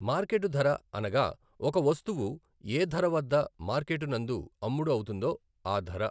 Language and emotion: Telugu, neutral